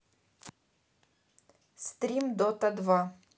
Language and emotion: Russian, neutral